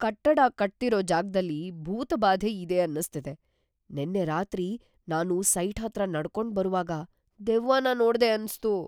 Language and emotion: Kannada, fearful